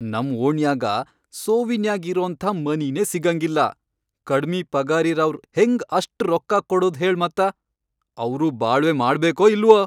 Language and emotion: Kannada, angry